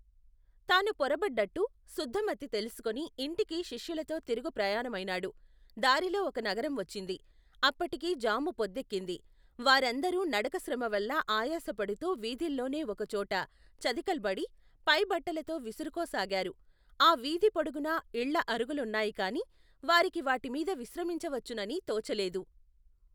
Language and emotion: Telugu, neutral